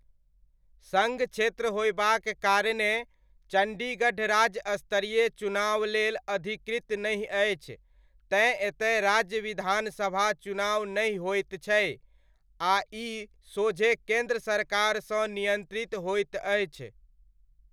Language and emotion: Maithili, neutral